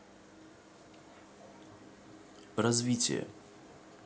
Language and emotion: Russian, neutral